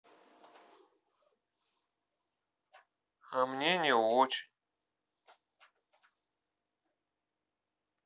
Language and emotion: Russian, sad